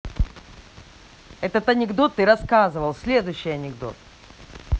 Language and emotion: Russian, angry